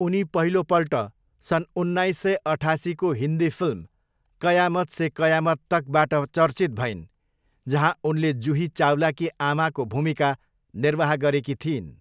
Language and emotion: Nepali, neutral